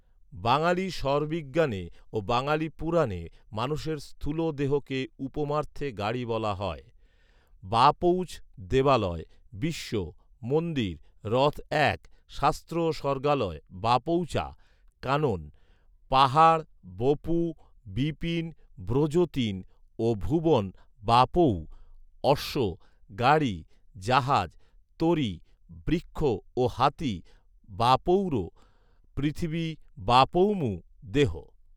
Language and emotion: Bengali, neutral